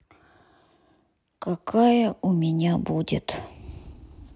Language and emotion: Russian, sad